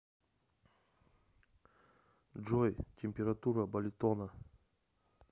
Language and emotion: Russian, neutral